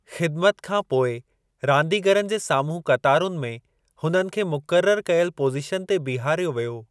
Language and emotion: Sindhi, neutral